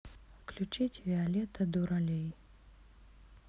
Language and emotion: Russian, neutral